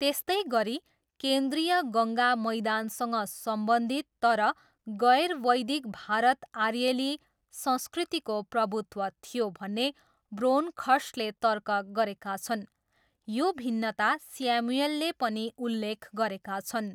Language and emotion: Nepali, neutral